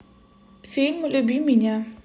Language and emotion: Russian, neutral